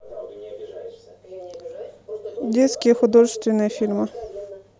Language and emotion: Russian, neutral